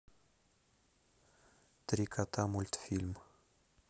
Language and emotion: Russian, neutral